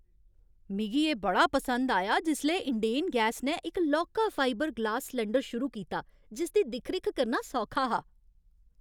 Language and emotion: Dogri, happy